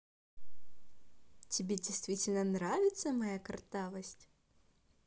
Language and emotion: Russian, positive